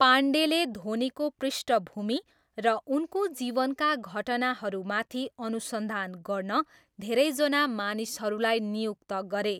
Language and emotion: Nepali, neutral